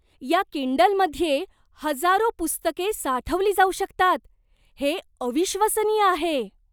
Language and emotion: Marathi, surprised